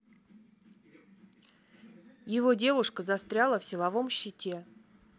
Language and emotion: Russian, neutral